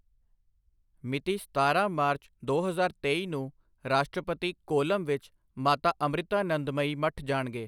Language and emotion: Punjabi, neutral